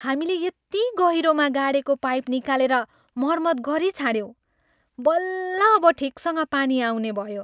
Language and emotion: Nepali, happy